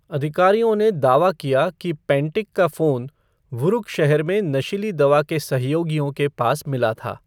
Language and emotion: Hindi, neutral